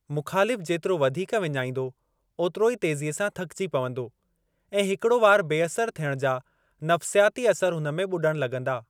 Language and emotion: Sindhi, neutral